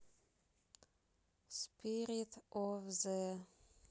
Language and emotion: Russian, neutral